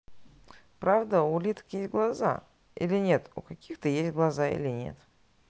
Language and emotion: Russian, neutral